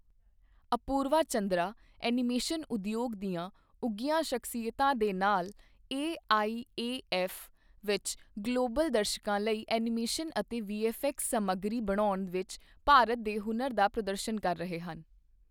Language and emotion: Punjabi, neutral